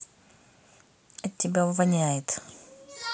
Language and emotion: Russian, neutral